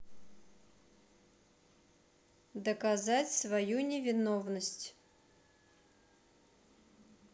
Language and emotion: Russian, neutral